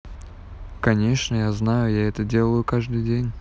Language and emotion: Russian, neutral